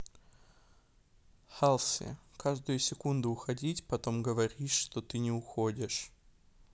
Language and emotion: Russian, neutral